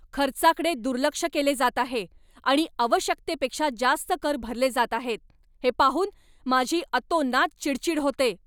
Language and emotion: Marathi, angry